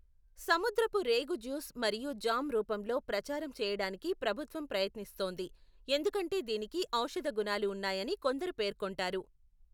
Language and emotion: Telugu, neutral